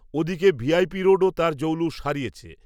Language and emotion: Bengali, neutral